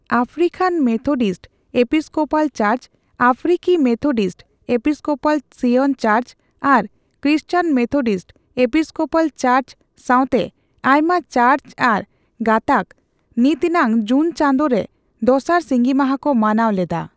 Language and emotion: Santali, neutral